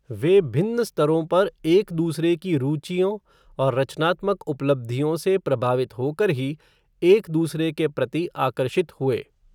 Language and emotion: Hindi, neutral